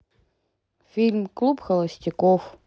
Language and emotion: Russian, neutral